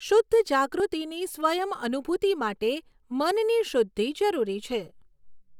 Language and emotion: Gujarati, neutral